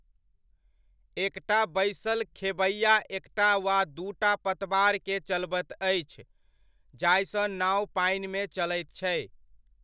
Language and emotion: Maithili, neutral